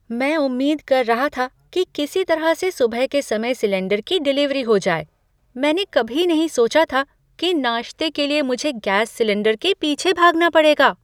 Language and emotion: Hindi, surprised